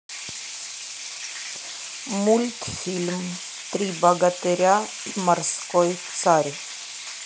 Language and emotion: Russian, neutral